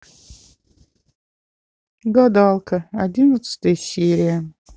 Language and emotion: Russian, sad